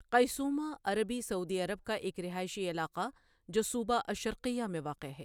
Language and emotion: Urdu, neutral